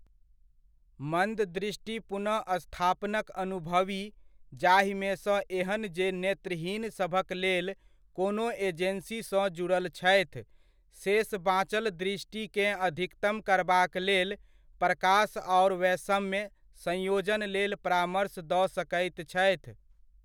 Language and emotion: Maithili, neutral